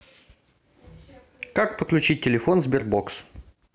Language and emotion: Russian, neutral